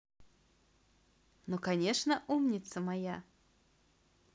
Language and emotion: Russian, positive